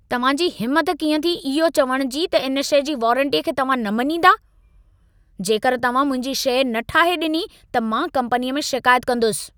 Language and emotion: Sindhi, angry